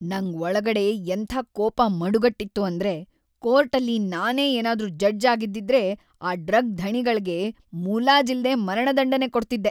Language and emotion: Kannada, angry